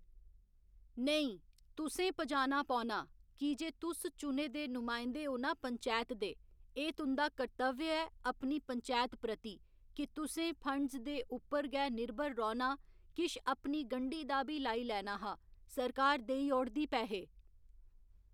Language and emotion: Dogri, neutral